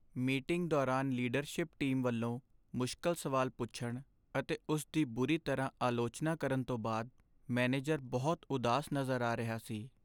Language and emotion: Punjabi, sad